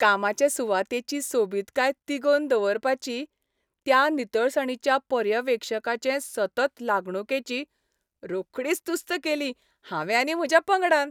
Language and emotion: Goan Konkani, happy